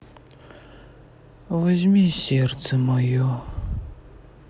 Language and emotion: Russian, sad